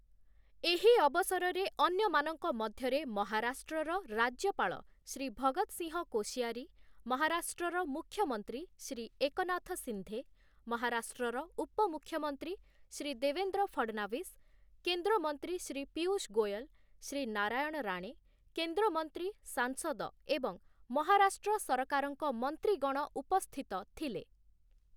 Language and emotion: Odia, neutral